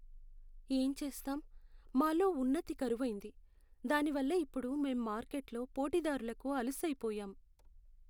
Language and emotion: Telugu, sad